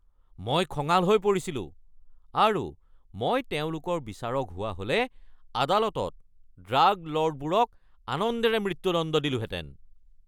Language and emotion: Assamese, angry